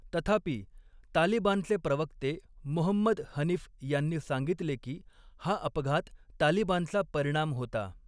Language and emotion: Marathi, neutral